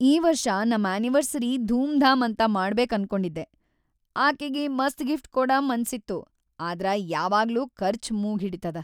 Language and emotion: Kannada, sad